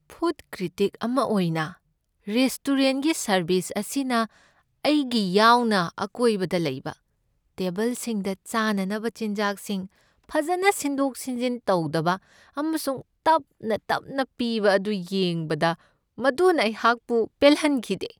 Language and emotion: Manipuri, sad